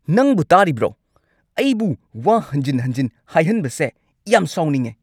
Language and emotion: Manipuri, angry